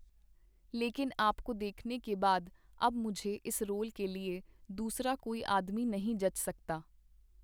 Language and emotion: Punjabi, neutral